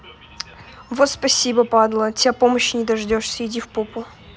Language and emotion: Russian, angry